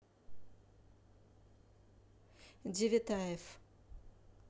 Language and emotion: Russian, neutral